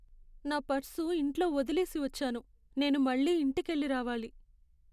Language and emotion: Telugu, sad